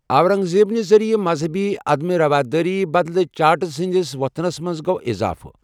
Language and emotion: Kashmiri, neutral